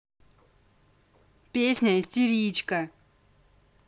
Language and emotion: Russian, angry